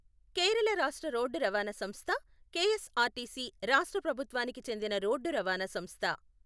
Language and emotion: Telugu, neutral